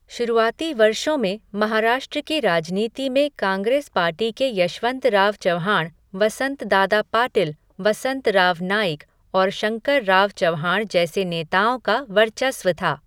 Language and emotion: Hindi, neutral